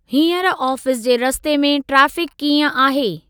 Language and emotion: Sindhi, neutral